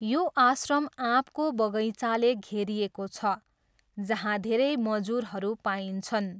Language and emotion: Nepali, neutral